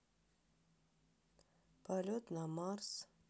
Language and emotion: Russian, sad